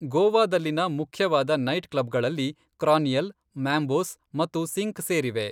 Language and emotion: Kannada, neutral